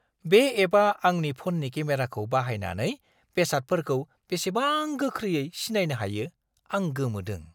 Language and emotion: Bodo, surprised